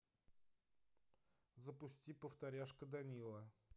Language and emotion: Russian, neutral